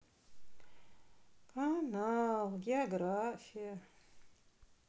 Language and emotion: Russian, sad